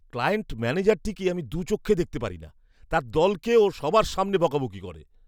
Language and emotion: Bengali, disgusted